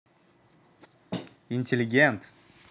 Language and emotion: Russian, positive